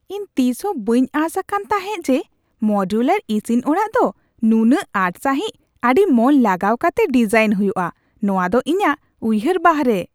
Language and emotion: Santali, surprised